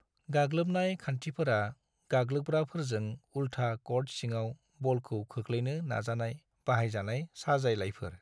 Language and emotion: Bodo, neutral